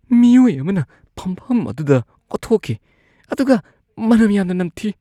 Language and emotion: Manipuri, disgusted